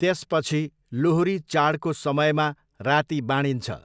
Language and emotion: Nepali, neutral